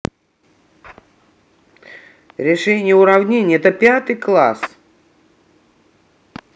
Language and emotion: Russian, neutral